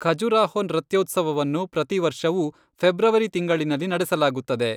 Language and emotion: Kannada, neutral